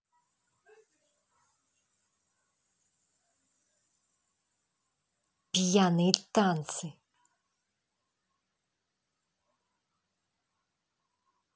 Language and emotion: Russian, angry